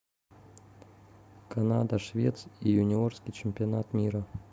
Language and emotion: Russian, neutral